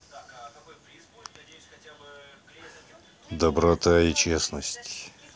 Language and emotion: Russian, neutral